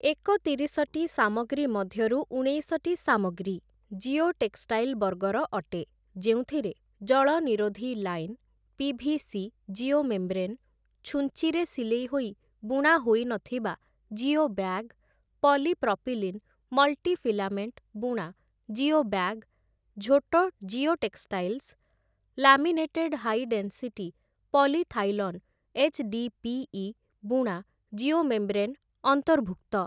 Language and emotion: Odia, neutral